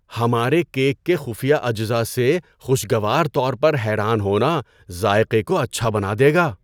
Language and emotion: Urdu, surprised